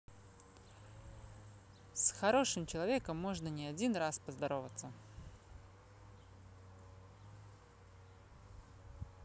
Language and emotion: Russian, positive